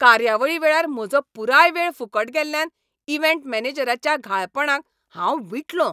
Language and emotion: Goan Konkani, angry